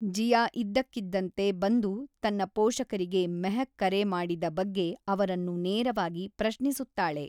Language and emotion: Kannada, neutral